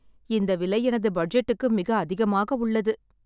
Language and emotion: Tamil, sad